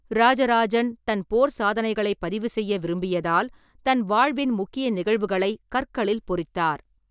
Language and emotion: Tamil, neutral